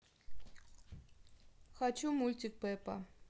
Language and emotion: Russian, neutral